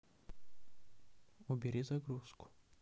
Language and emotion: Russian, neutral